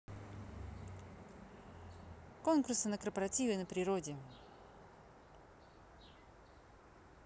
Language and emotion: Russian, neutral